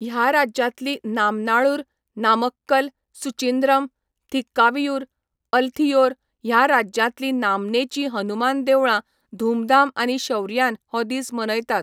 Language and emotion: Goan Konkani, neutral